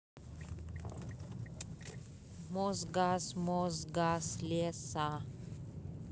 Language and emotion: Russian, neutral